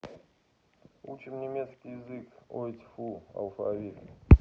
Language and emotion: Russian, neutral